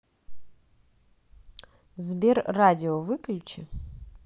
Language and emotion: Russian, neutral